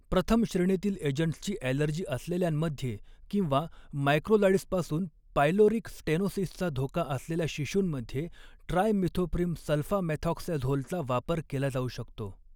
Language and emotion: Marathi, neutral